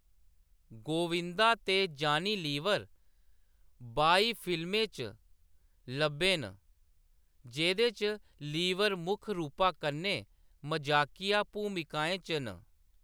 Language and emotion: Dogri, neutral